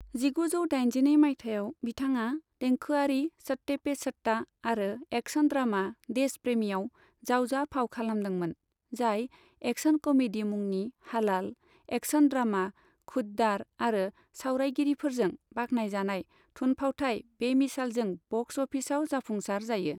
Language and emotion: Bodo, neutral